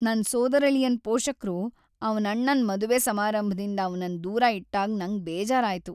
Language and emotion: Kannada, sad